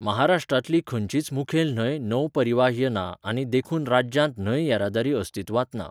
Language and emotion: Goan Konkani, neutral